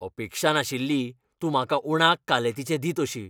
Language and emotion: Goan Konkani, angry